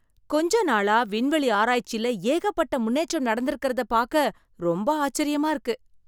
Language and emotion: Tamil, surprised